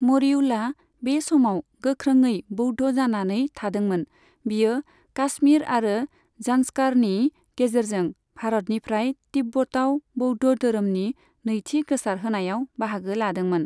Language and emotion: Bodo, neutral